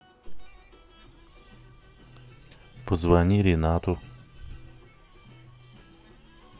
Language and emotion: Russian, neutral